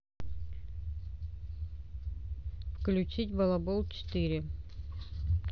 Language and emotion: Russian, neutral